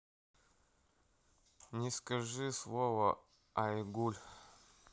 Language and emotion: Russian, neutral